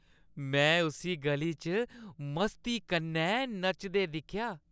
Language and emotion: Dogri, happy